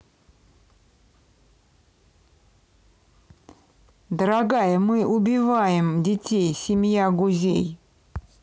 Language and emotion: Russian, neutral